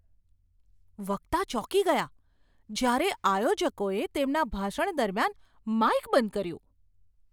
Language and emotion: Gujarati, surprised